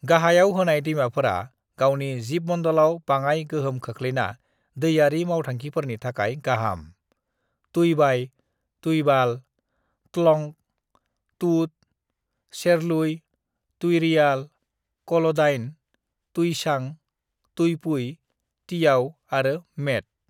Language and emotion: Bodo, neutral